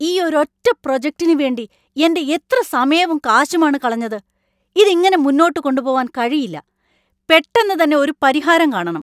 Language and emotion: Malayalam, angry